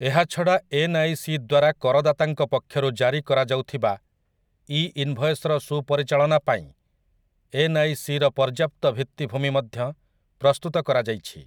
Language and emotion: Odia, neutral